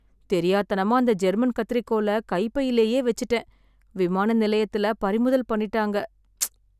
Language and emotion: Tamil, sad